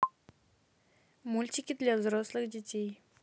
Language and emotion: Russian, neutral